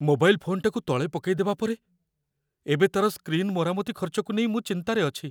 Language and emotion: Odia, fearful